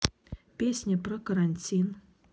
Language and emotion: Russian, neutral